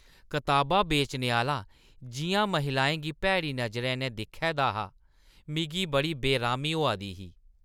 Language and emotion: Dogri, disgusted